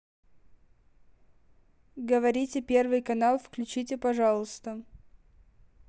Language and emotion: Russian, neutral